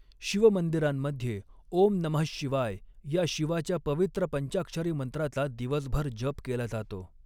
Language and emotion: Marathi, neutral